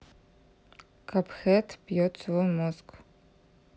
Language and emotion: Russian, neutral